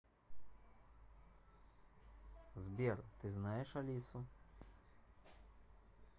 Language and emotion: Russian, neutral